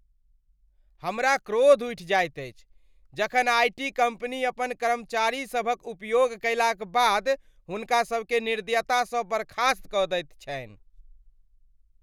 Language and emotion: Maithili, angry